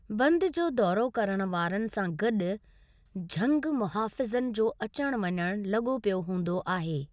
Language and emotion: Sindhi, neutral